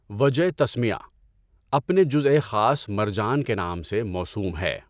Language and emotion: Urdu, neutral